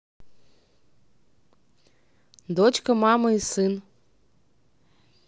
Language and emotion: Russian, neutral